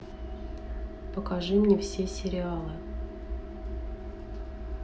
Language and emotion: Russian, neutral